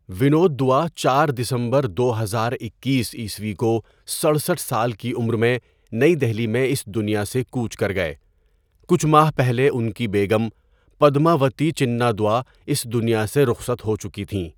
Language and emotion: Urdu, neutral